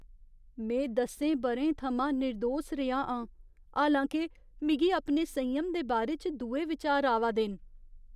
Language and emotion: Dogri, fearful